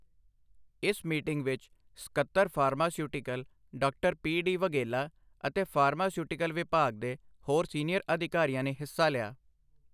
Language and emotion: Punjabi, neutral